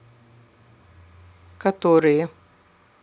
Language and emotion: Russian, neutral